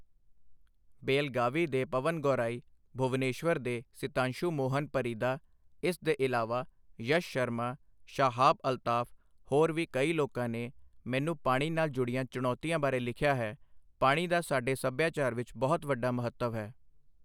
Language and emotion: Punjabi, neutral